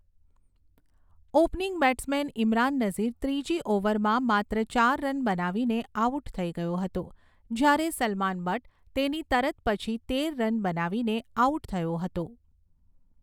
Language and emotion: Gujarati, neutral